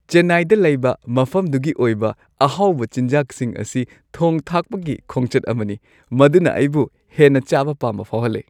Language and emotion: Manipuri, happy